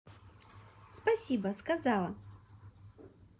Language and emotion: Russian, positive